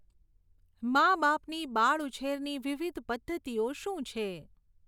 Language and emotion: Gujarati, neutral